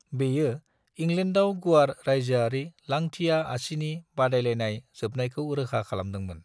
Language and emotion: Bodo, neutral